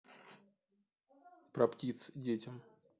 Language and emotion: Russian, neutral